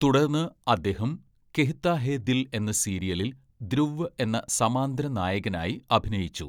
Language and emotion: Malayalam, neutral